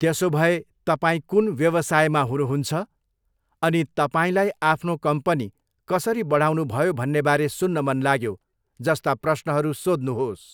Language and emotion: Nepali, neutral